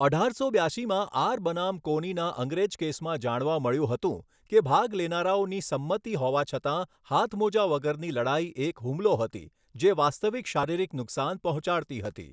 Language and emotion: Gujarati, neutral